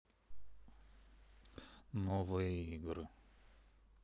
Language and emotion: Russian, neutral